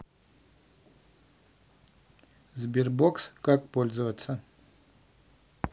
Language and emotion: Russian, neutral